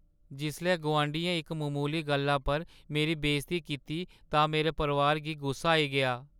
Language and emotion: Dogri, sad